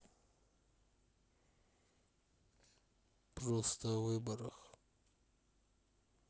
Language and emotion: Russian, sad